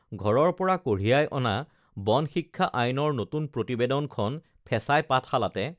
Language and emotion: Assamese, neutral